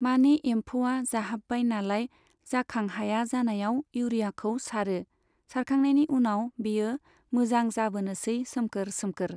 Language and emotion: Bodo, neutral